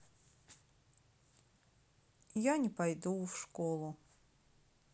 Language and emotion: Russian, sad